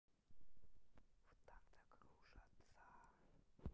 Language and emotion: Russian, neutral